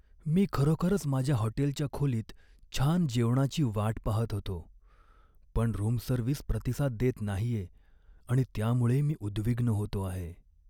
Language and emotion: Marathi, sad